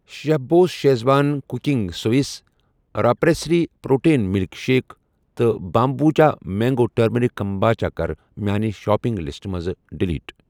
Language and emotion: Kashmiri, neutral